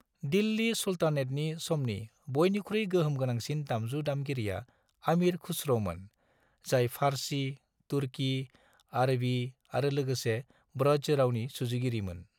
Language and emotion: Bodo, neutral